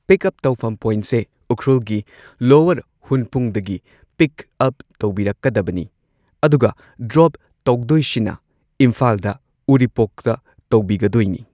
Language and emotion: Manipuri, neutral